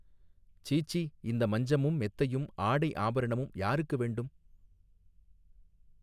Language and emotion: Tamil, neutral